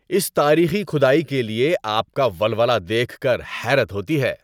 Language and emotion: Urdu, happy